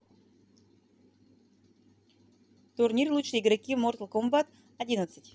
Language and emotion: Russian, neutral